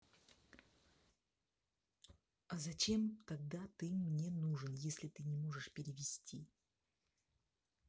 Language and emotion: Russian, neutral